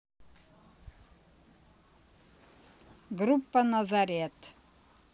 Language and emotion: Russian, neutral